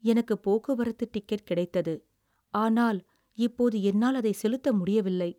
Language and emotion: Tamil, sad